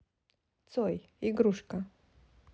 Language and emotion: Russian, neutral